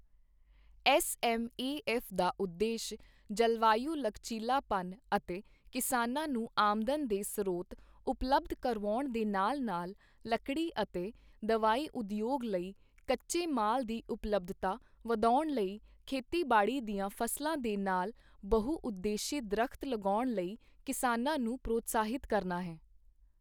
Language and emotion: Punjabi, neutral